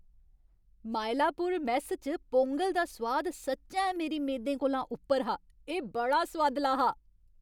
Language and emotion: Dogri, happy